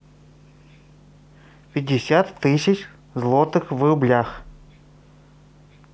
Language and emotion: Russian, neutral